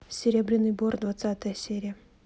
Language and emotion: Russian, neutral